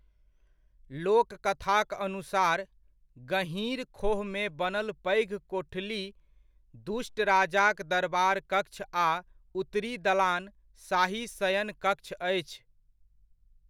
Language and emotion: Maithili, neutral